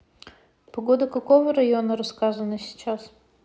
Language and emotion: Russian, neutral